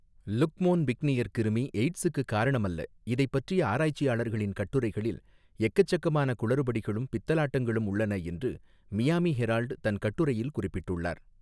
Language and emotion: Tamil, neutral